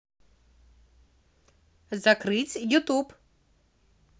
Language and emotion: Russian, positive